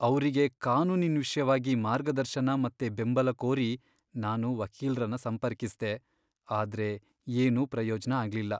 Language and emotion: Kannada, sad